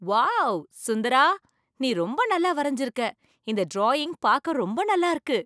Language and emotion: Tamil, surprised